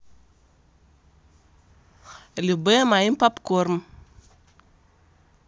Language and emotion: Russian, neutral